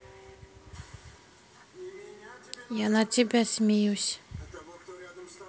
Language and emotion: Russian, neutral